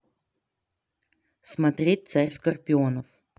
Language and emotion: Russian, neutral